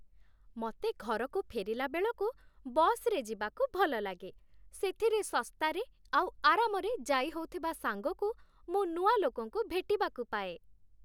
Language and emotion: Odia, happy